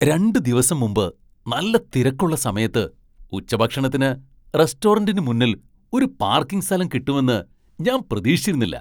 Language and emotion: Malayalam, surprised